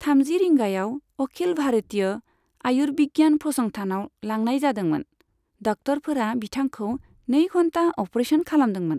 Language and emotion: Bodo, neutral